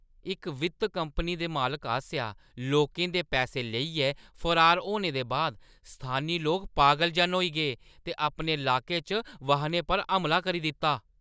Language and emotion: Dogri, angry